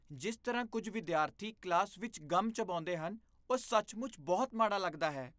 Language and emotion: Punjabi, disgusted